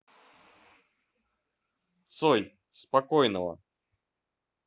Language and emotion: Russian, neutral